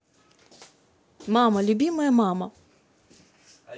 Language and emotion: Russian, positive